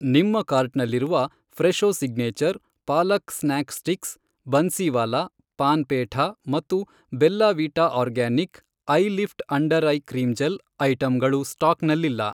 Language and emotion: Kannada, neutral